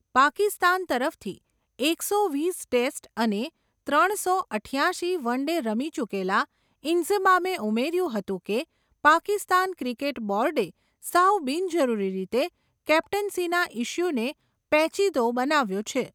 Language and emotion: Gujarati, neutral